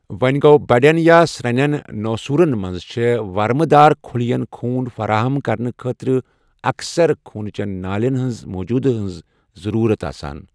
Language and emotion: Kashmiri, neutral